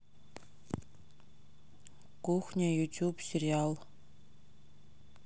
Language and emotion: Russian, neutral